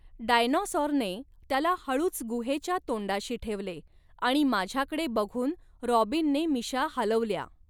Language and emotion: Marathi, neutral